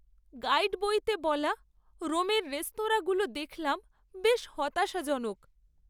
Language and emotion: Bengali, sad